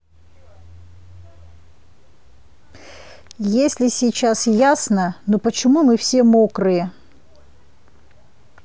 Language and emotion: Russian, neutral